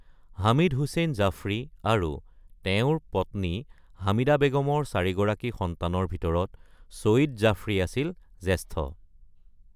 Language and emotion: Assamese, neutral